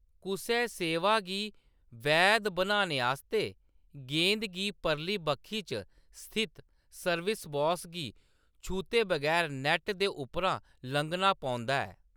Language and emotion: Dogri, neutral